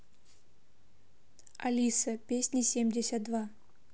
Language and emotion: Russian, neutral